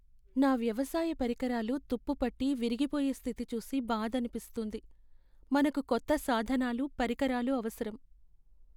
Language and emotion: Telugu, sad